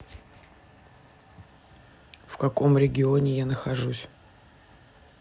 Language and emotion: Russian, neutral